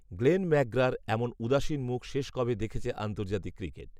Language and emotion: Bengali, neutral